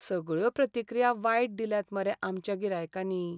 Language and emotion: Goan Konkani, sad